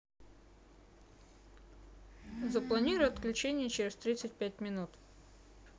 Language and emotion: Russian, neutral